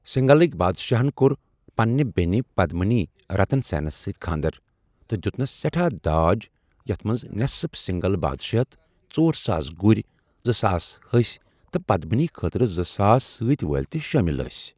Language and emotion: Kashmiri, neutral